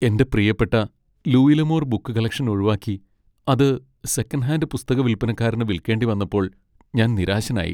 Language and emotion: Malayalam, sad